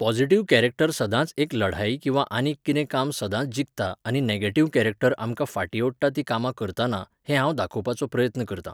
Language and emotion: Goan Konkani, neutral